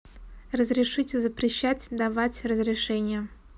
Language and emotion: Russian, neutral